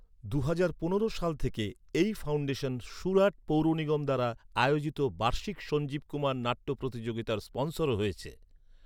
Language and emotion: Bengali, neutral